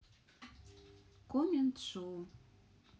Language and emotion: Russian, neutral